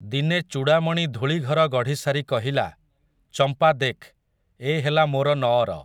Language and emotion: Odia, neutral